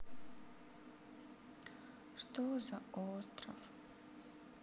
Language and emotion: Russian, sad